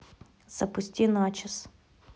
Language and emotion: Russian, neutral